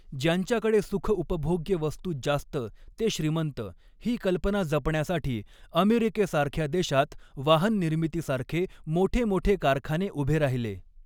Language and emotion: Marathi, neutral